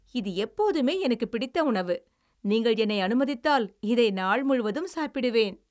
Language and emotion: Tamil, happy